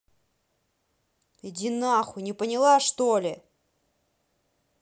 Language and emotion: Russian, angry